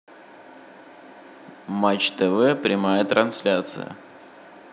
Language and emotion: Russian, neutral